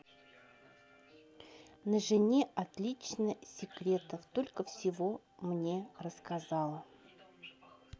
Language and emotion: Russian, neutral